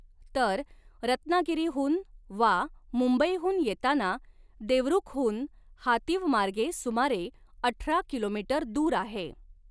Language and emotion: Marathi, neutral